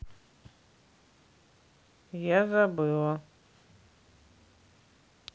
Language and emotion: Russian, neutral